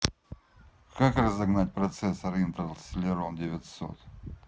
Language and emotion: Russian, neutral